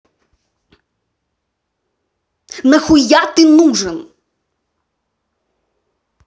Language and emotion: Russian, angry